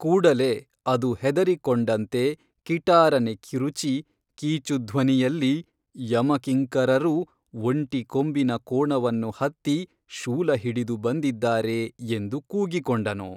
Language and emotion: Kannada, neutral